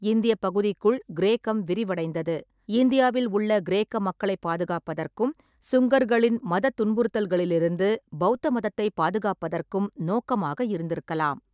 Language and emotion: Tamil, neutral